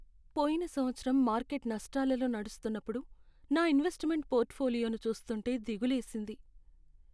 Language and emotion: Telugu, sad